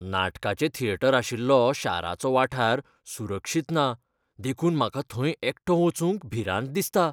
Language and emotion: Goan Konkani, fearful